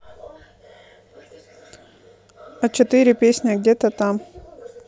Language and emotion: Russian, neutral